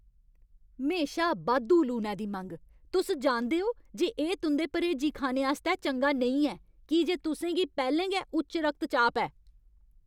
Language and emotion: Dogri, angry